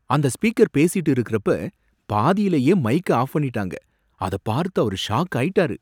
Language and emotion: Tamil, surprised